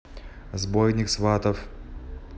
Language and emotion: Russian, neutral